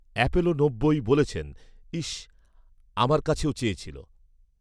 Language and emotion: Bengali, neutral